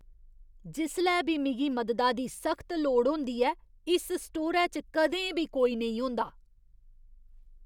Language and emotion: Dogri, disgusted